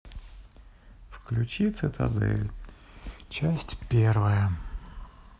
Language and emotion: Russian, sad